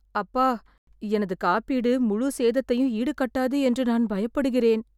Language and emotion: Tamil, fearful